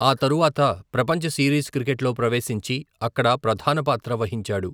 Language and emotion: Telugu, neutral